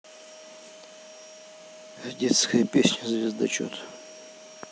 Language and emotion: Russian, neutral